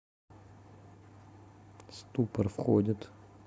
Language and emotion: Russian, neutral